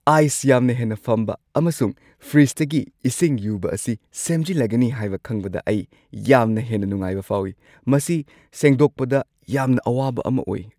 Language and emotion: Manipuri, happy